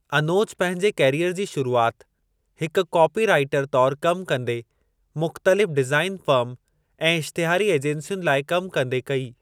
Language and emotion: Sindhi, neutral